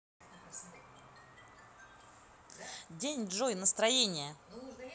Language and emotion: Russian, positive